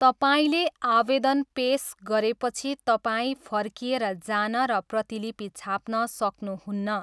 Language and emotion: Nepali, neutral